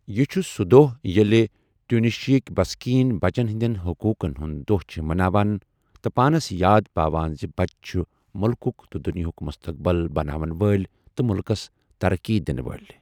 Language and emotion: Kashmiri, neutral